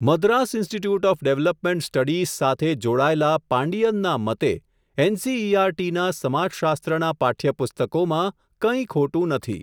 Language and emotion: Gujarati, neutral